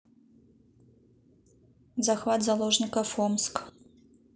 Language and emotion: Russian, neutral